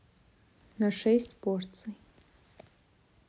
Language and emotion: Russian, neutral